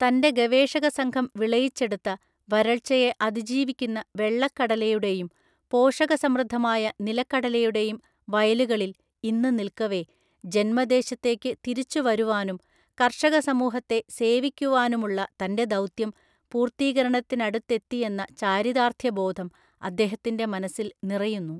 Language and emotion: Malayalam, neutral